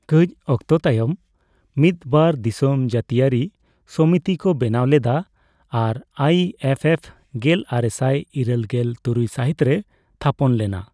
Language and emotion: Santali, neutral